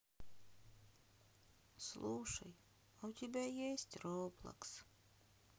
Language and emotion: Russian, sad